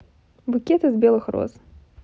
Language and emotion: Russian, neutral